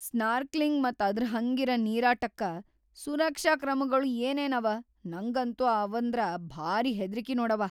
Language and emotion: Kannada, fearful